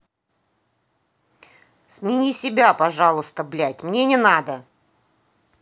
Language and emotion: Russian, angry